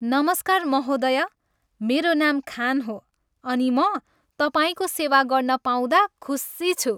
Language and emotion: Nepali, happy